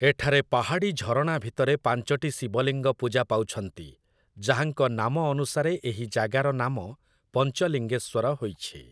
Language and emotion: Odia, neutral